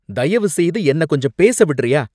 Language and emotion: Tamil, angry